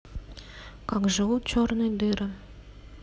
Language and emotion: Russian, neutral